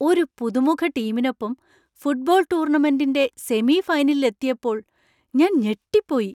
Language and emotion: Malayalam, surprised